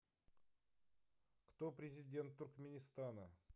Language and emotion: Russian, neutral